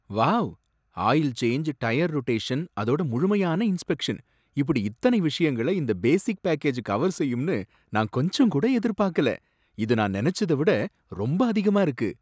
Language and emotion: Tamil, surprised